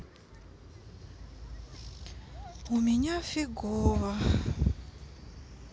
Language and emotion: Russian, sad